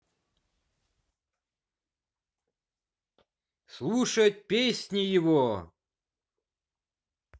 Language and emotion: Russian, positive